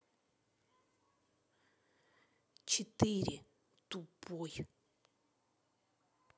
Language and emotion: Russian, angry